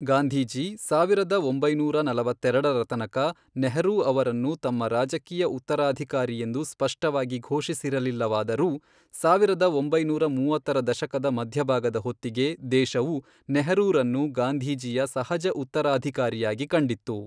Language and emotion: Kannada, neutral